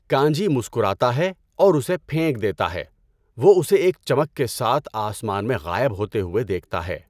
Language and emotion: Urdu, neutral